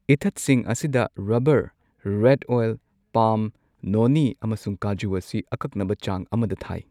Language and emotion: Manipuri, neutral